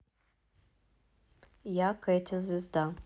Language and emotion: Russian, neutral